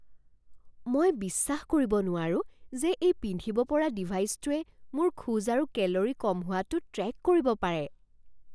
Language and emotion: Assamese, surprised